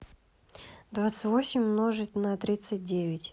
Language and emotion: Russian, neutral